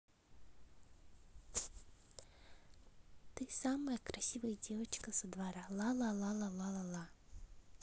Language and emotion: Russian, positive